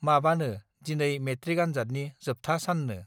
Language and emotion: Bodo, neutral